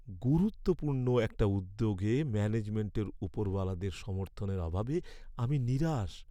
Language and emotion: Bengali, sad